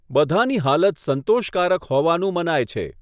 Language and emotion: Gujarati, neutral